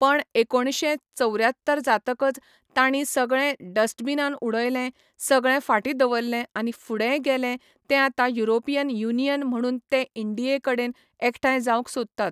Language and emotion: Goan Konkani, neutral